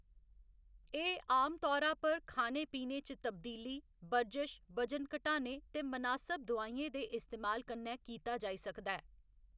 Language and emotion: Dogri, neutral